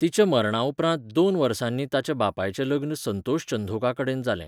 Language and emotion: Goan Konkani, neutral